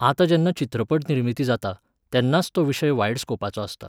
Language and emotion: Goan Konkani, neutral